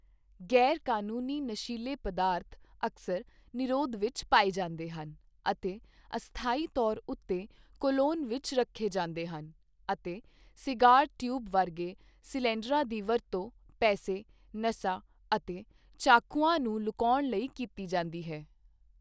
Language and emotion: Punjabi, neutral